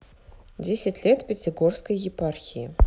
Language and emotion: Russian, neutral